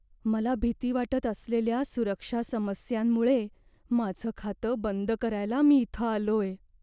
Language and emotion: Marathi, fearful